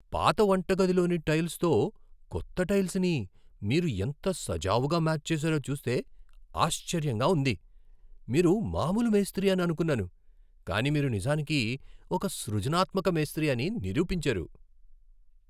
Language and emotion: Telugu, surprised